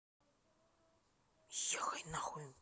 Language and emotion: Russian, angry